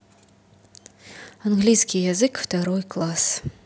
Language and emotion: Russian, neutral